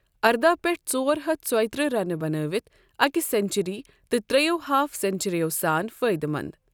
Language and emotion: Kashmiri, neutral